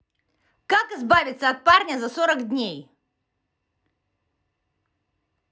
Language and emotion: Russian, angry